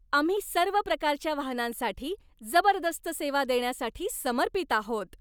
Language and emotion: Marathi, happy